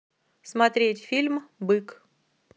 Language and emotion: Russian, neutral